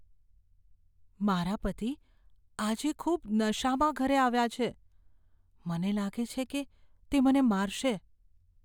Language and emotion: Gujarati, fearful